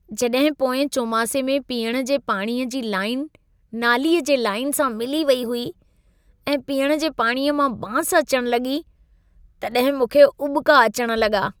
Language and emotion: Sindhi, disgusted